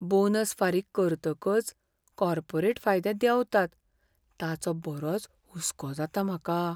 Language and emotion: Goan Konkani, fearful